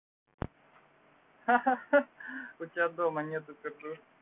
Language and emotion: Russian, positive